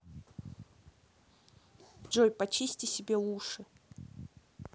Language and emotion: Russian, neutral